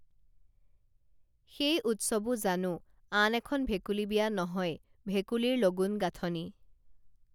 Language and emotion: Assamese, neutral